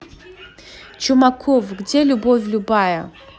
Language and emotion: Russian, angry